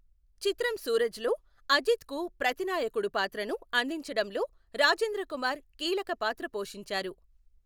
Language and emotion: Telugu, neutral